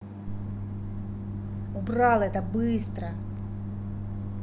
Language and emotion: Russian, angry